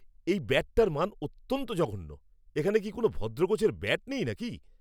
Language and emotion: Bengali, angry